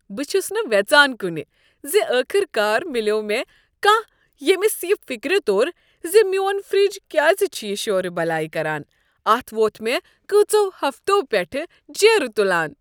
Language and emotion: Kashmiri, happy